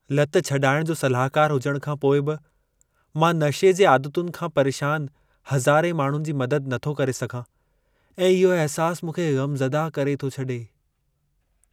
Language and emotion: Sindhi, sad